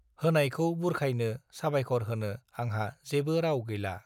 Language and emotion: Bodo, neutral